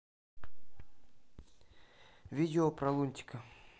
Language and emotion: Russian, neutral